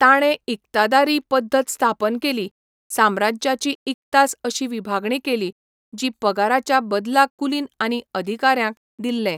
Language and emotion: Goan Konkani, neutral